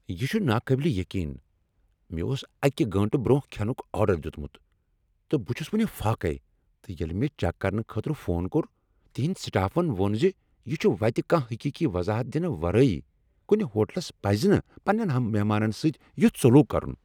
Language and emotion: Kashmiri, angry